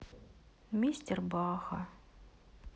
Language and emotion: Russian, sad